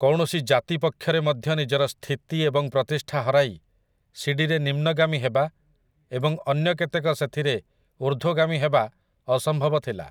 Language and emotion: Odia, neutral